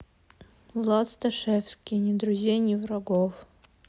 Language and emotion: Russian, neutral